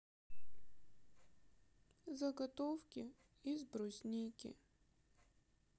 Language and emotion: Russian, sad